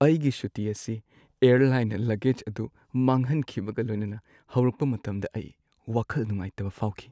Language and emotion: Manipuri, sad